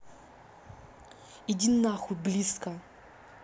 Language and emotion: Russian, angry